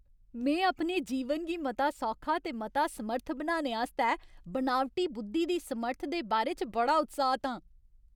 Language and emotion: Dogri, happy